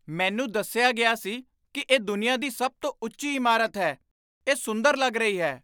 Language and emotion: Punjabi, surprised